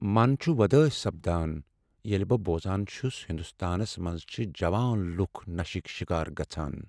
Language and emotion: Kashmiri, sad